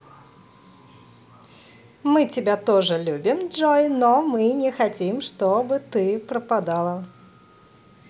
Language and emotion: Russian, positive